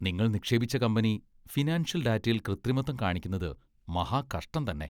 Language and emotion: Malayalam, disgusted